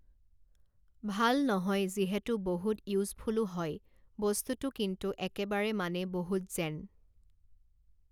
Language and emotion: Assamese, neutral